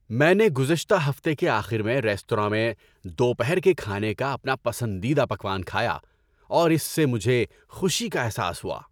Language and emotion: Urdu, happy